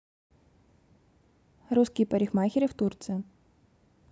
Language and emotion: Russian, neutral